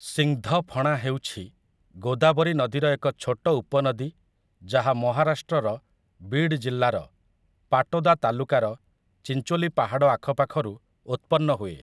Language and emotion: Odia, neutral